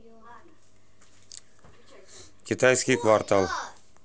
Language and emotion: Russian, neutral